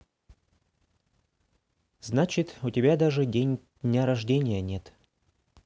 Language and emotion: Russian, neutral